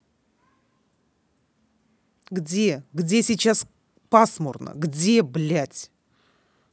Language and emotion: Russian, angry